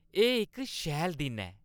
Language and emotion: Dogri, happy